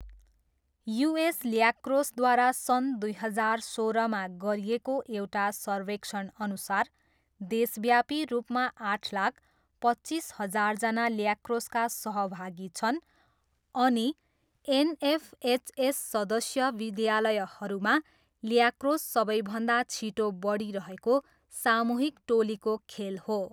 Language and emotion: Nepali, neutral